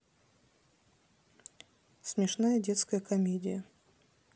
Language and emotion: Russian, neutral